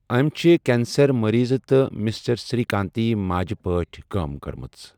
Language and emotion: Kashmiri, neutral